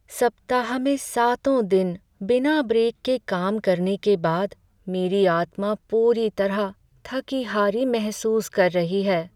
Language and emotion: Hindi, sad